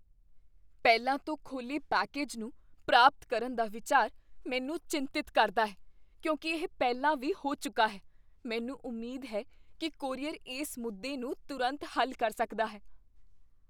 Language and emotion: Punjabi, fearful